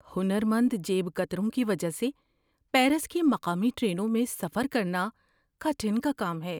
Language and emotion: Urdu, fearful